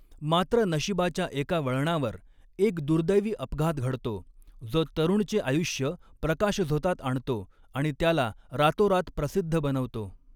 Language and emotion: Marathi, neutral